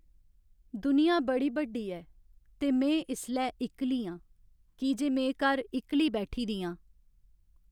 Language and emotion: Dogri, sad